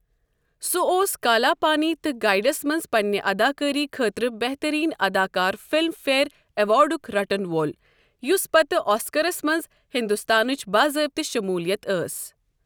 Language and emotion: Kashmiri, neutral